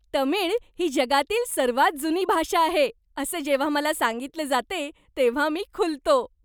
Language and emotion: Marathi, happy